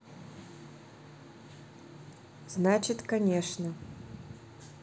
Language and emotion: Russian, neutral